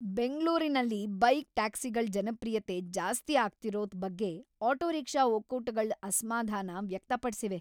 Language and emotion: Kannada, angry